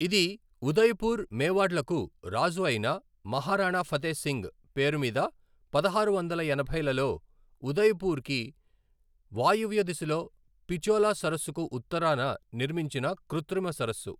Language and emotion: Telugu, neutral